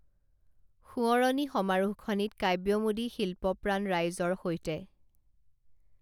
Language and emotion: Assamese, neutral